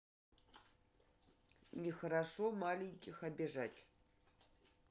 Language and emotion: Russian, neutral